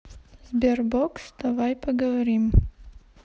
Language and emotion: Russian, neutral